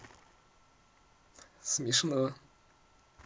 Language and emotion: Russian, positive